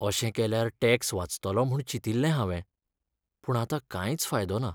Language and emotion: Goan Konkani, sad